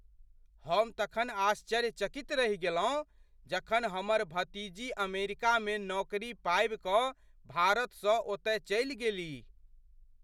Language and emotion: Maithili, surprised